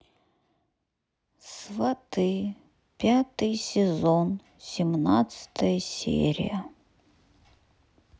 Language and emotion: Russian, sad